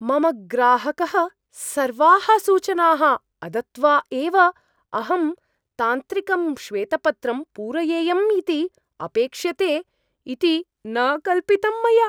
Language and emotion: Sanskrit, surprised